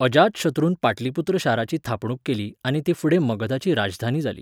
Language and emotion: Goan Konkani, neutral